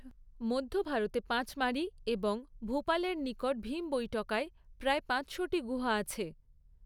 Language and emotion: Bengali, neutral